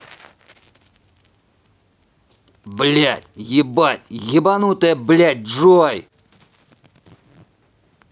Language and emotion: Russian, angry